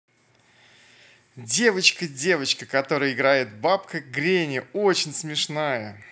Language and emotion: Russian, positive